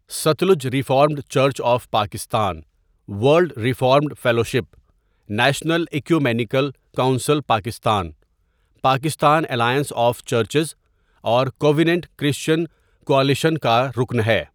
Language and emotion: Urdu, neutral